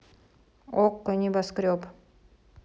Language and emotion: Russian, neutral